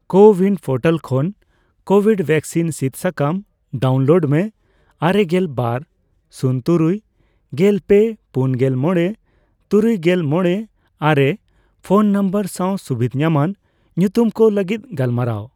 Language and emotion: Santali, neutral